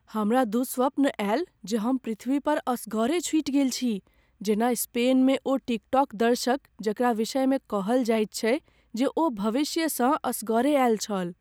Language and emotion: Maithili, fearful